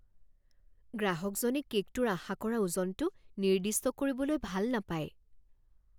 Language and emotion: Assamese, fearful